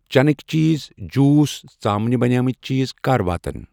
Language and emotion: Kashmiri, neutral